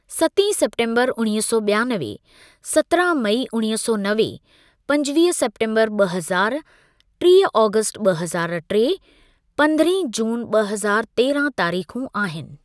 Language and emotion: Sindhi, neutral